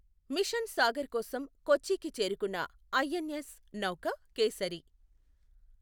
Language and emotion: Telugu, neutral